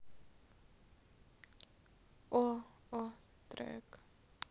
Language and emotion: Russian, sad